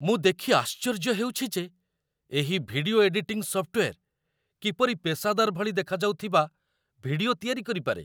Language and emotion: Odia, surprised